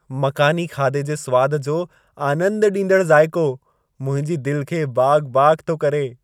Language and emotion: Sindhi, happy